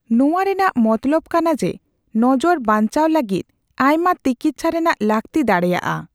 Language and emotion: Santali, neutral